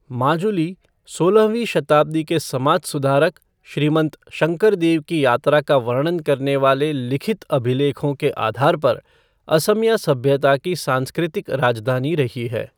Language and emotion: Hindi, neutral